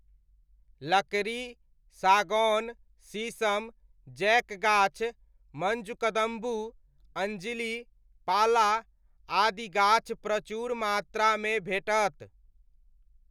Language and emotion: Maithili, neutral